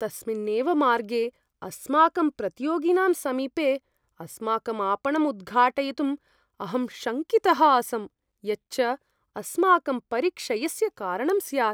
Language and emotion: Sanskrit, fearful